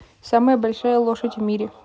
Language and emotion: Russian, neutral